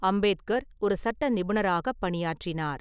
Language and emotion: Tamil, neutral